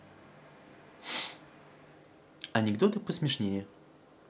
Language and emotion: Russian, positive